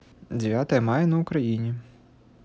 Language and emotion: Russian, neutral